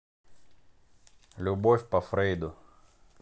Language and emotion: Russian, neutral